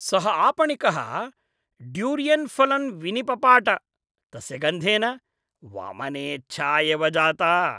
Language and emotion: Sanskrit, disgusted